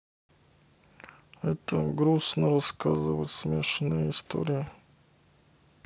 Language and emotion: Russian, sad